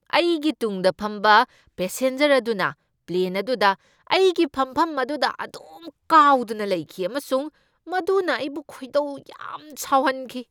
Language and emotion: Manipuri, angry